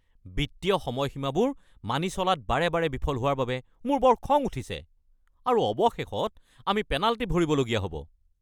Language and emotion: Assamese, angry